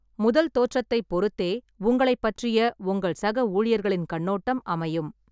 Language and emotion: Tamil, neutral